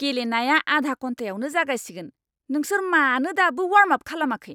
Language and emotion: Bodo, angry